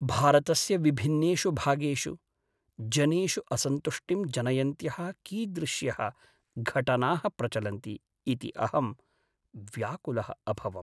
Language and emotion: Sanskrit, sad